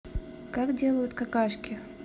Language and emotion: Russian, neutral